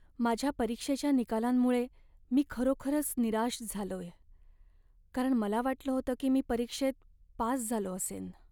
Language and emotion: Marathi, sad